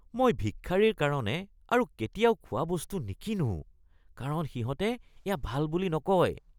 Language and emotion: Assamese, disgusted